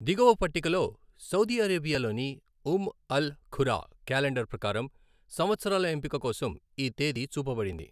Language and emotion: Telugu, neutral